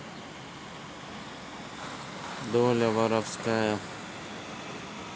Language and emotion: Russian, sad